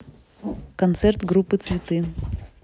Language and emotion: Russian, neutral